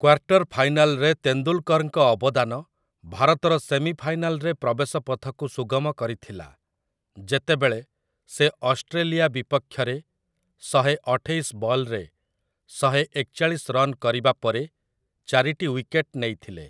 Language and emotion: Odia, neutral